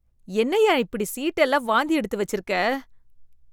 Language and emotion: Tamil, disgusted